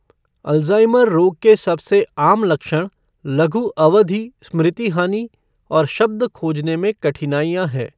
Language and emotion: Hindi, neutral